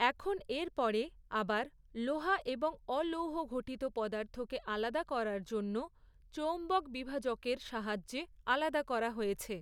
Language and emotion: Bengali, neutral